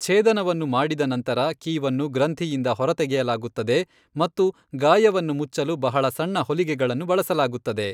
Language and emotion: Kannada, neutral